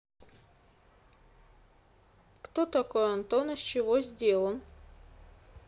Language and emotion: Russian, neutral